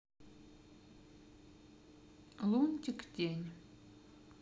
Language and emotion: Russian, neutral